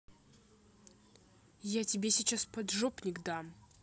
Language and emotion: Russian, angry